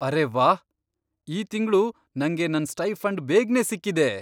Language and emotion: Kannada, surprised